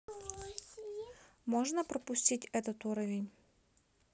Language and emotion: Russian, neutral